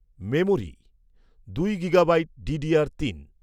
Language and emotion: Bengali, neutral